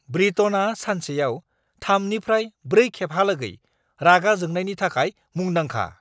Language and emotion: Bodo, angry